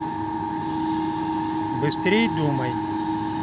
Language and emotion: Russian, neutral